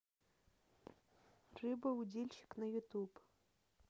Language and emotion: Russian, neutral